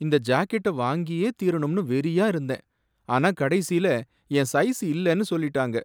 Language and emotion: Tamil, sad